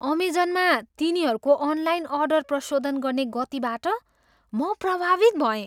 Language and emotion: Nepali, surprised